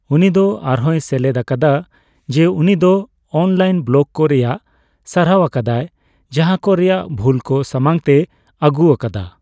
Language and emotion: Santali, neutral